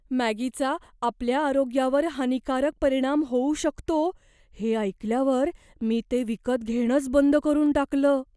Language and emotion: Marathi, fearful